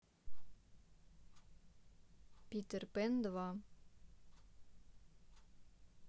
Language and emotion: Russian, neutral